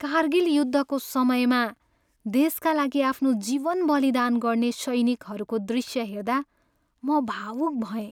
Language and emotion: Nepali, sad